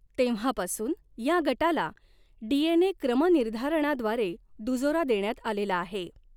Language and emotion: Marathi, neutral